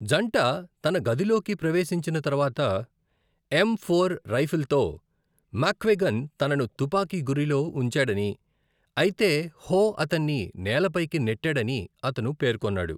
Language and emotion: Telugu, neutral